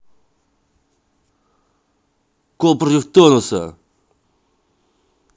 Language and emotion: Russian, angry